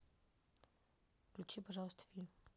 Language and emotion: Russian, neutral